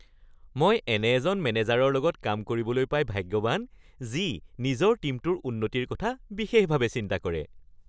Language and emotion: Assamese, happy